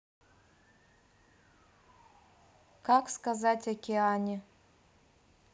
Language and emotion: Russian, neutral